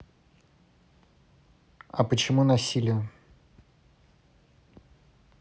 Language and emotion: Russian, neutral